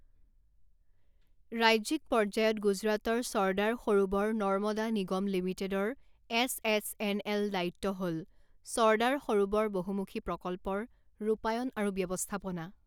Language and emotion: Assamese, neutral